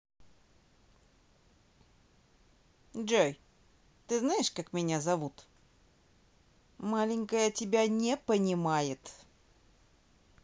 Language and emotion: Russian, neutral